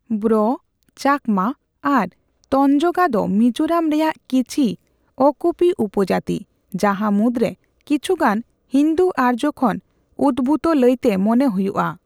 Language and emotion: Santali, neutral